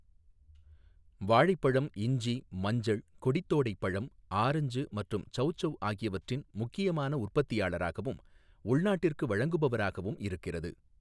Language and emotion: Tamil, neutral